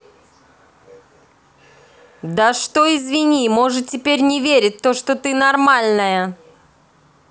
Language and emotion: Russian, angry